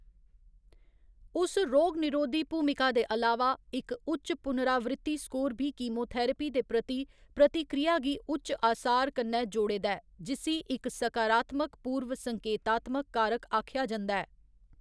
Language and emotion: Dogri, neutral